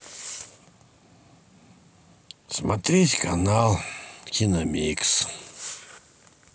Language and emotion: Russian, sad